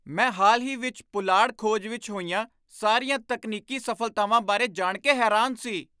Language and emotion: Punjabi, surprised